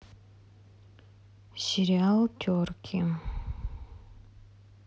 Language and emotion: Russian, neutral